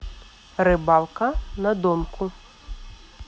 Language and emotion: Russian, neutral